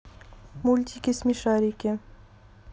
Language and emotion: Russian, neutral